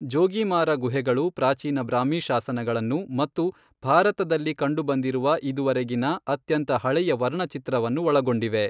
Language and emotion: Kannada, neutral